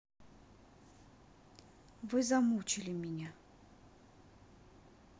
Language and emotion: Russian, neutral